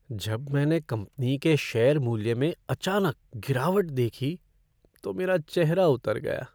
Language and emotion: Hindi, sad